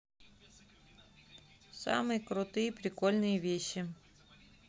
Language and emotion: Russian, neutral